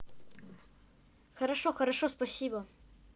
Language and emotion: Russian, neutral